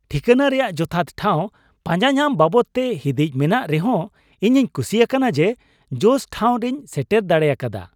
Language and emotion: Santali, happy